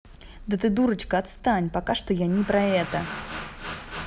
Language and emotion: Russian, angry